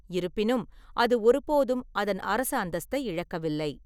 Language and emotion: Tamil, neutral